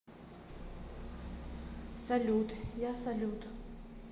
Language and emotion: Russian, neutral